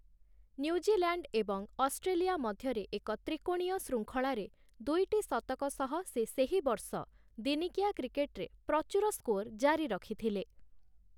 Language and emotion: Odia, neutral